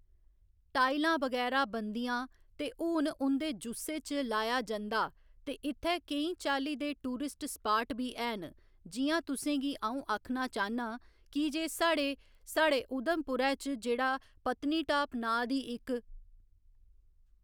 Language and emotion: Dogri, neutral